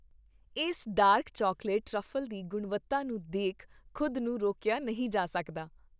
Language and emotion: Punjabi, happy